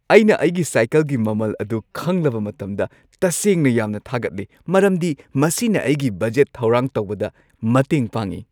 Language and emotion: Manipuri, happy